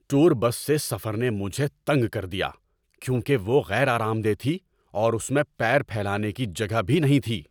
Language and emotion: Urdu, angry